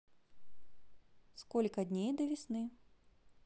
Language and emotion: Russian, neutral